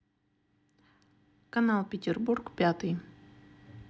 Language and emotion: Russian, neutral